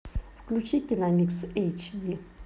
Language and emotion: Russian, neutral